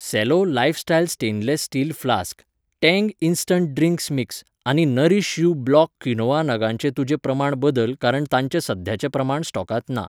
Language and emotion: Goan Konkani, neutral